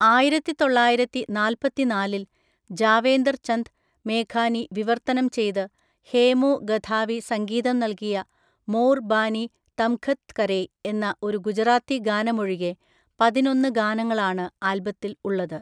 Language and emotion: Malayalam, neutral